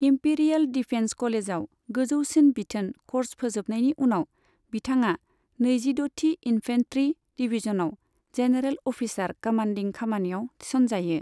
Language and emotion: Bodo, neutral